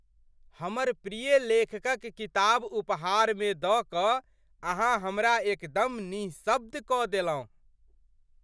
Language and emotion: Maithili, surprised